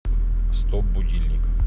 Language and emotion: Russian, neutral